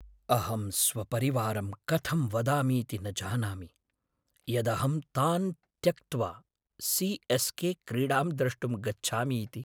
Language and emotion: Sanskrit, sad